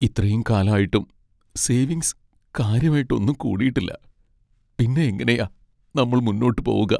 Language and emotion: Malayalam, sad